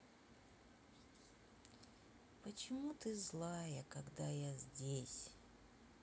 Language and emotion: Russian, sad